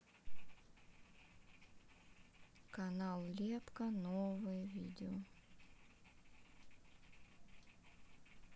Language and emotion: Russian, sad